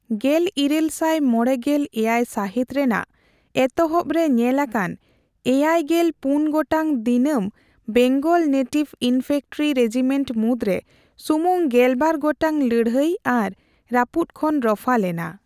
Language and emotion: Santali, neutral